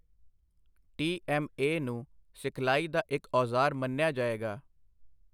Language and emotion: Punjabi, neutral